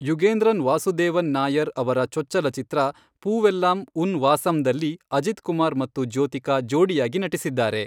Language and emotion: Kannada, neutral